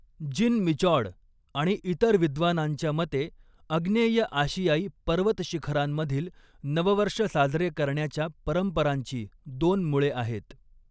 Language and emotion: Marathi, neutral